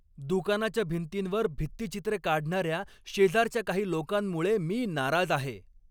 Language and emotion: Marathi, angry